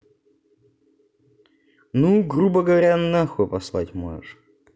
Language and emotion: Russian, neutral